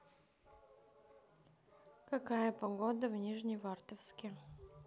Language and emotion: Russian, neutral